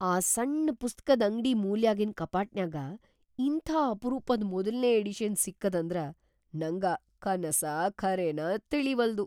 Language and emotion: Kannada, surprised